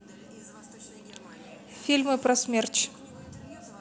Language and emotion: Russian, neutral